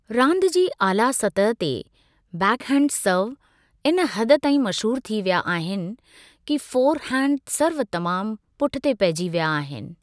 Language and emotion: Sindhi, neutral